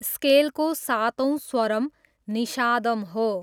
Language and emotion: Nepali, neutral